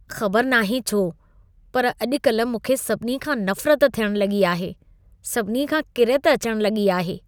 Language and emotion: Sindhi, disgusted